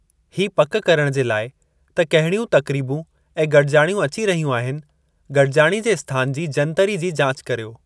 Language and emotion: Sindhi, neutral